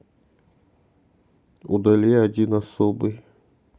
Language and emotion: Russian, neutral